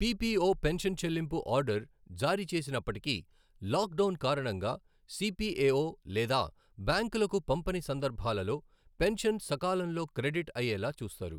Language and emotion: Telugu, neutral